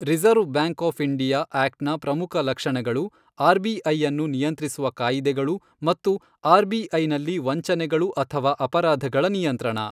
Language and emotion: Kannada, neutral